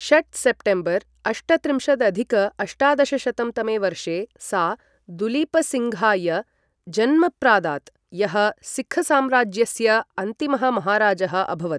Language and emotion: Sanskrit, neutral